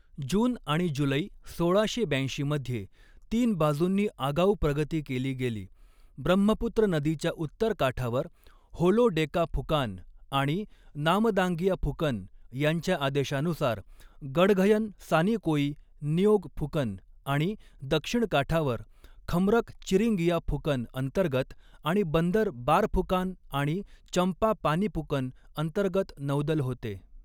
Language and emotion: Marathi, neutral